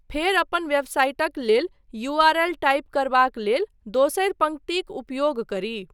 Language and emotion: Maithili, neutral